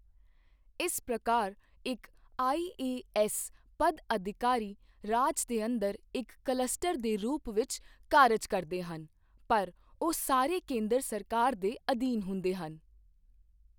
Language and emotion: Punjabi, neutral